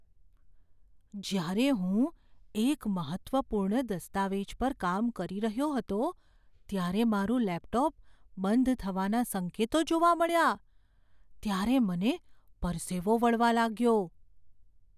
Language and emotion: Gujarati, fearful